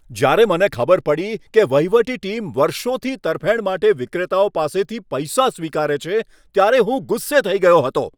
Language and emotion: Gujarati, angry